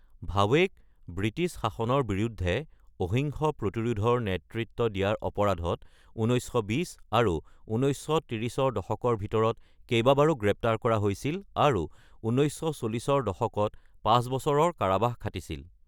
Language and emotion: Assamese, neutral